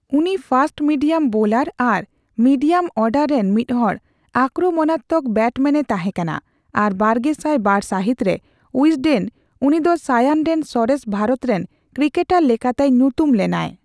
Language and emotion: Santali, neutral